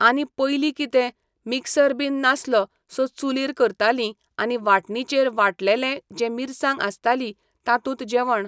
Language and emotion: Goan Konkani, neutral